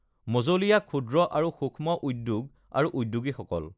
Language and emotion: Assamese, neutral